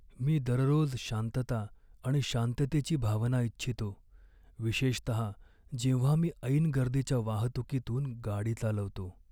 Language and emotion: Marathi, sad